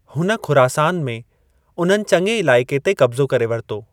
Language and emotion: Sindhi, neutral